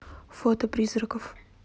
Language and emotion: Russian, neutral